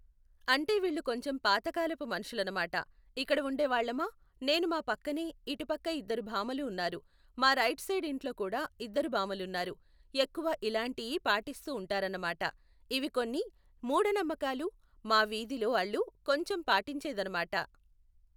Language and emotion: Telugu, neutral